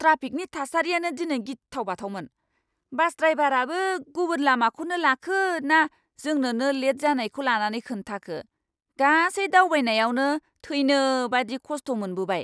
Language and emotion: Bodo, angry